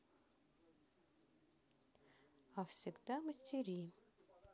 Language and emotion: Russian, neutral